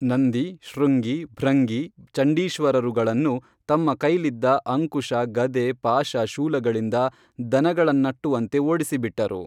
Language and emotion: Kannada, neutral